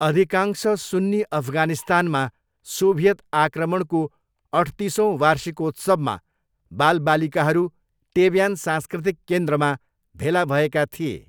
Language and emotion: Nepali, neutral